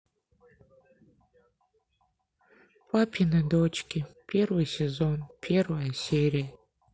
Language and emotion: Russian, sad